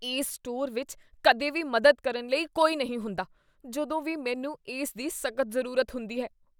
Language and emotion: Punjabi, disgusted